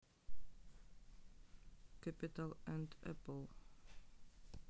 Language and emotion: Russian, neutral